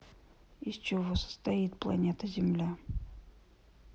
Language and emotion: Russian, neutral